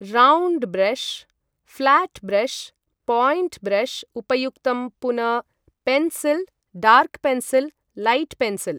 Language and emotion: Sanskrit, neutral